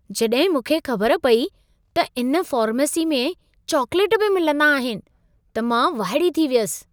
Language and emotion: Sindhi, surprised